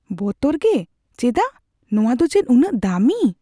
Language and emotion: Santali, fearful